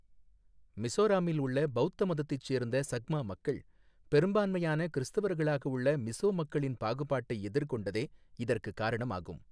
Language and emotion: Tamil, neutral